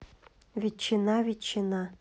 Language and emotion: Russian, neutral